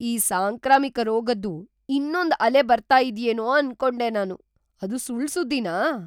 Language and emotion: Kannada, surprised